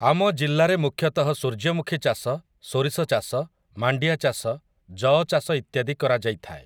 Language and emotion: Odia, neutral